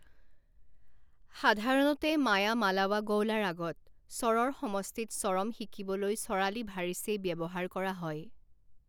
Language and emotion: Assamese, neutral